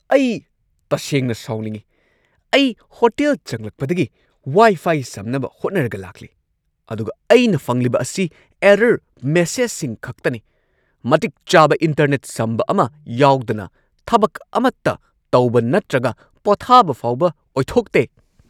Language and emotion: Manipuri, angry